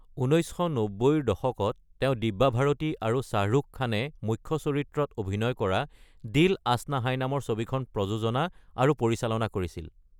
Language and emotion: Assamese, neutral